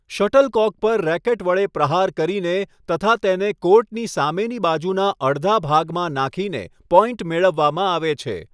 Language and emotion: Gujarati, neutral